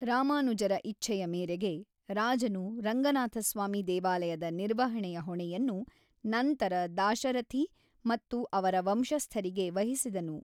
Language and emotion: Kannada, neutral